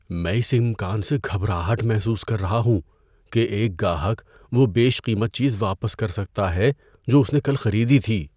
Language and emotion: Urdu, fearful